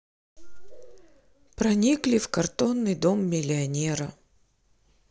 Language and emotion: Russian, neutral